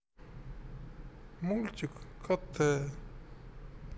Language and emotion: Russian, sad